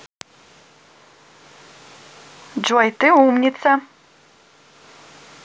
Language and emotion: Russian, positive